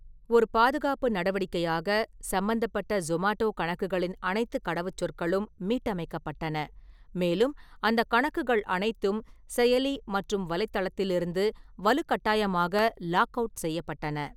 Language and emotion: Tamil, neutral